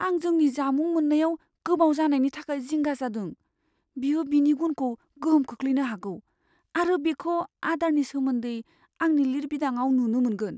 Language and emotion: Bodo, fearful